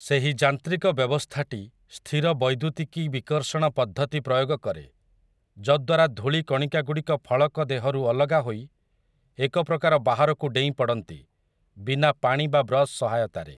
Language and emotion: Odia, neutral